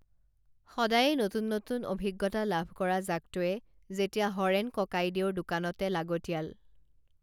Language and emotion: Assamese, neutral